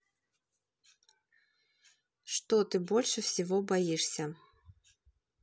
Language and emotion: Russian, neutral